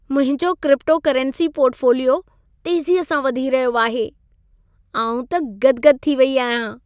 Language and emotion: Sindhi, happy